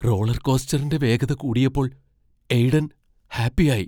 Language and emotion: Malayalam, fearful